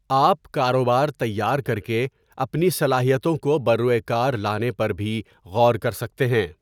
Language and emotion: Urdu, neutral